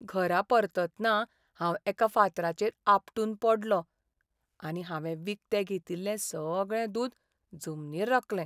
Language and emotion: Goan Konkani, sad